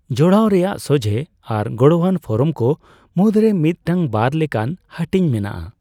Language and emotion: Santali, neutral